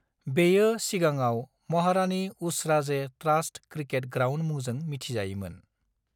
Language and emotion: Bodo, neutral